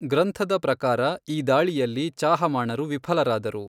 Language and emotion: Kannada, neutral